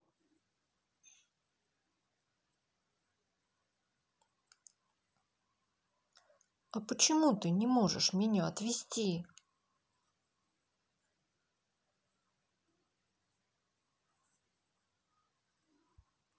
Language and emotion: Russian, sad